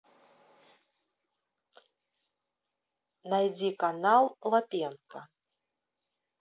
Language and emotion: Russian, neutral